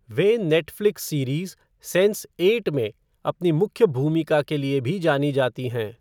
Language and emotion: Hindi, neutral